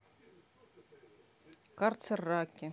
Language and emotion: Russian, neutral